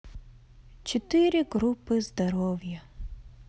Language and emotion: Russian, sad